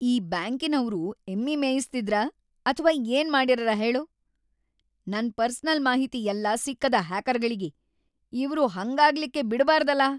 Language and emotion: Kannada, angry